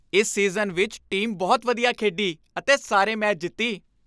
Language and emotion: Punjabi, happy